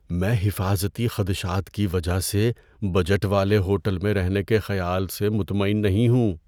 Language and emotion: Urdu, fearful